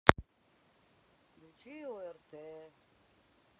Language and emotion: Russian, sad